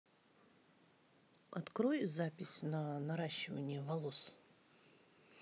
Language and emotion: Russian, neutral